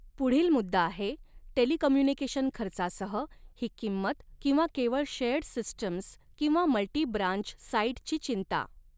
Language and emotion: Marathi, neutral